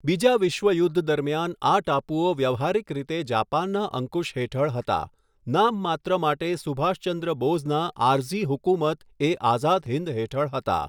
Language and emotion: Gujarati, neutral